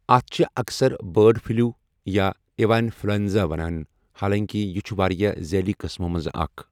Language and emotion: Kashmiri, neutral